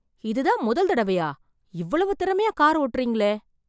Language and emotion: Tamil, surprised